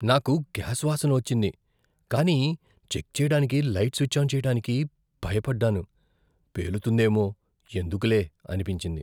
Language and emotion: Telugu, fearful